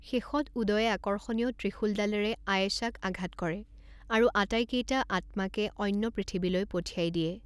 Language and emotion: Assamese, neutral